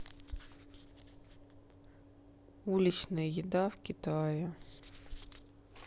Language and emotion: Russian, sad